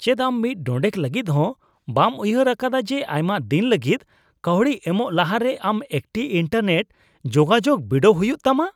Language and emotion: Santali, disgusted